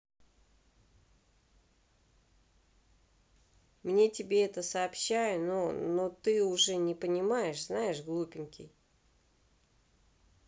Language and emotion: Russian, neutral